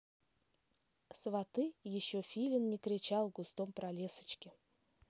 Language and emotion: Russian, neutral